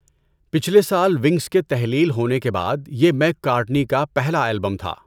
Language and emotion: Urdu, neutral